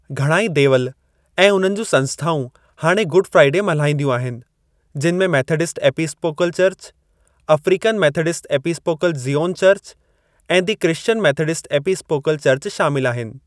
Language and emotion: Sindhi, neutral